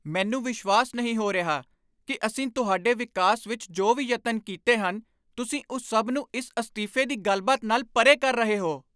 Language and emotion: Punjabi, angry